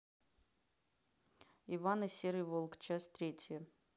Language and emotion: Russian, neutral